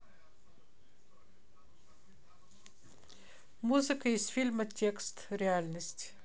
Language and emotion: Russian, neutral